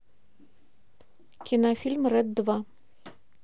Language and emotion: Russian, neutral